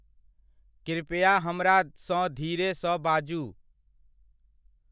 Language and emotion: Maithili, neutral